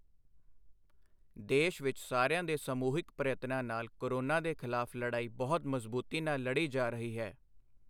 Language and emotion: Punjabi, neutral